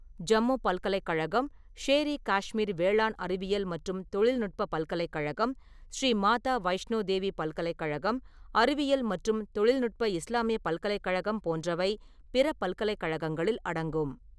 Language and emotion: Tamil, neutral